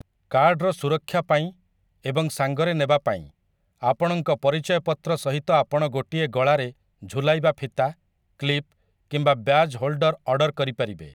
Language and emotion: Odia, neutral